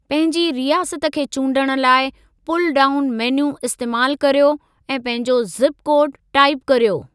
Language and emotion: Sindhi, neutral